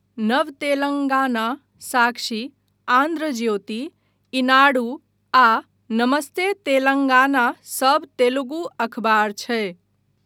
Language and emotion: Maithili, neutral